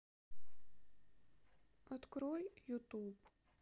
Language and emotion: Russian, sad